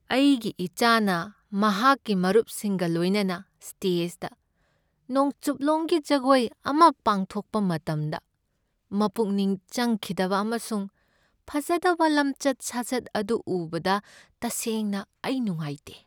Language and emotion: Manipuri, sad